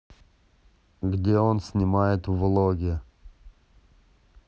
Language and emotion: Russian, neutral